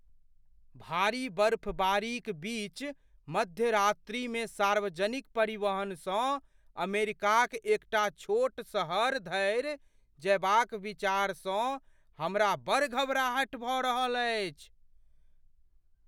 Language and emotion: Maithili, fearful